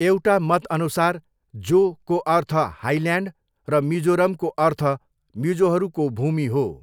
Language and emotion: Nepali, neutral